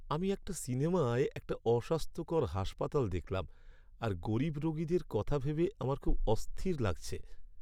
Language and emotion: Bengali, sad